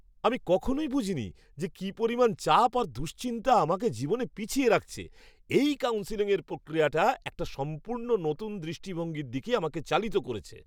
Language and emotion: Bengali, surprised